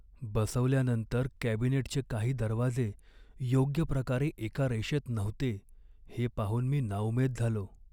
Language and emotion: Marathi, sad